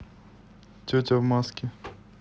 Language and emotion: Russian, neutral